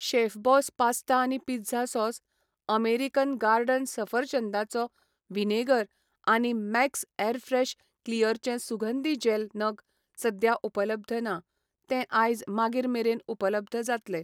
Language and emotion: Goan Konkani, neutral